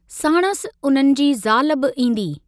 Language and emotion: Sindhi, neutral